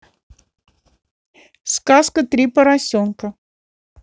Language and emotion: Russian, neutral